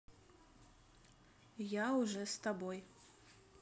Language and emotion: Russian, neutral